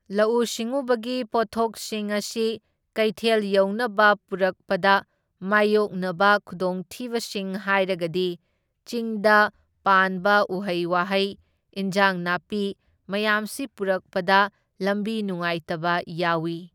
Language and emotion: Manipuri, neutral